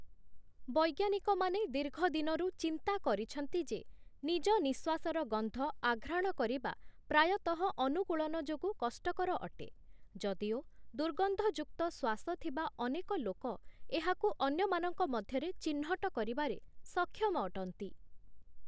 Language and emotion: Odia, neutral